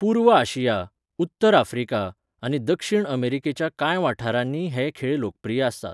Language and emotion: Goan Konkani, neutral